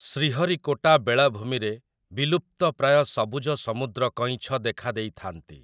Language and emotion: Odia, neutral